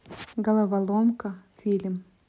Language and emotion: Russian, neutral